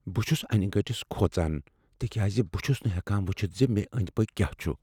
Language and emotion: Kashmiri, fearful